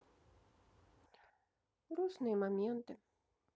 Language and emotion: Russian, sad